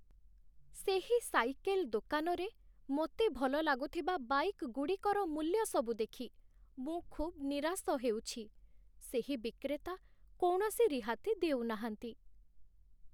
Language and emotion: Odia, sad